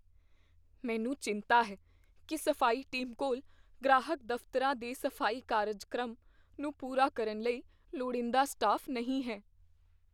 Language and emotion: Punjabi, fearful